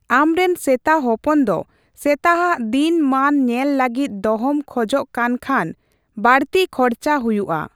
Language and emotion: Santali, neutral